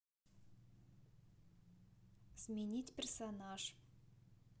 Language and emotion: Russian, neutral